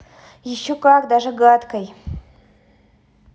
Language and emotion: Russian, angry